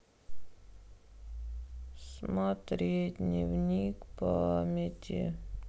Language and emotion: Russian, sad